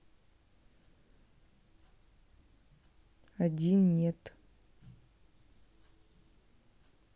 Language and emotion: Russian, sad